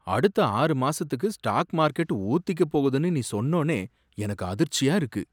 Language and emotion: Tamil, surprised